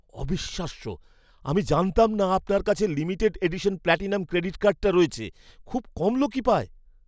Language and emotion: Bengali, surprised